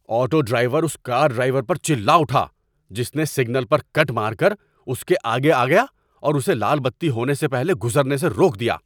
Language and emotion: Urdu, angry